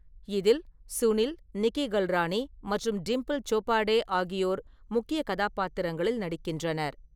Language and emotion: Tamil, neutral